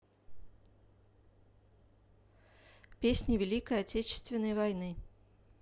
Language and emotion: Russian, neutral